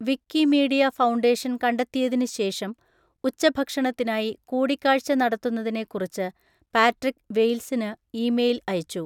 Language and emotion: Malayalam, neutral